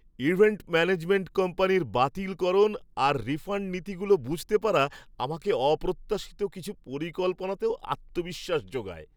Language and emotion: Bengali, happy